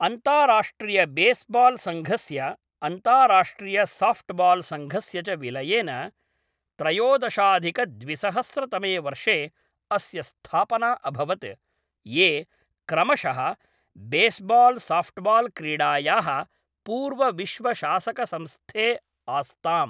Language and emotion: Sanskrit, neutral